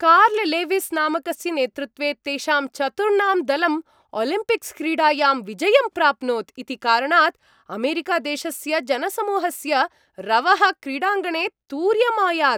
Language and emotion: Sanskrit, happy